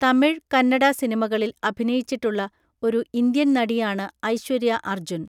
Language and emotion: Malayalam, neutral